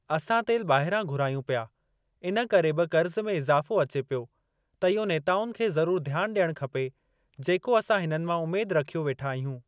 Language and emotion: Sindhi, neutral